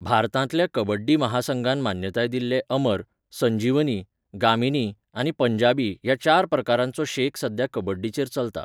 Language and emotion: Goan Konkani, neutral